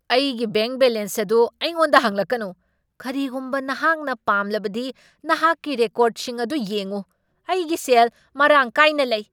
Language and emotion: Manipuri, angry